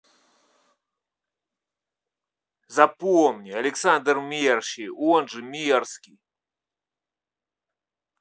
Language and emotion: Russian, angry